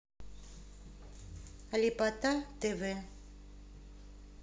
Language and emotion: Russian, neutral